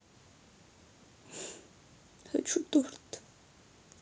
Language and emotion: Russian, sad